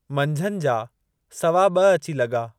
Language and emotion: Sindhi, neutral